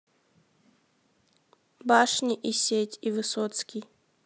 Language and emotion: Russian, neutral